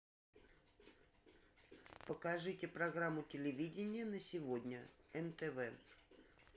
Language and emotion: Russian, neutral